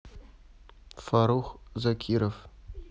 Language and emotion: Russian, neutral